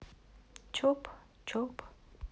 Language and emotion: Russian, neutral